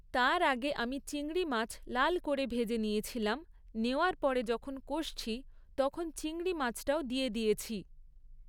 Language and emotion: Bengali, neutral